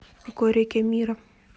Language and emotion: Russian, neutral